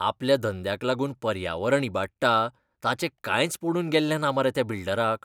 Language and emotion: Goan Konkani, disgusted